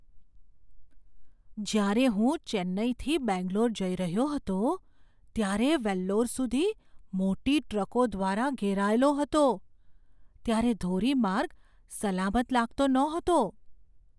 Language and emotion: Gujarati, fearful